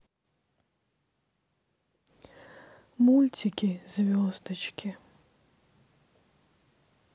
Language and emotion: Russian, sad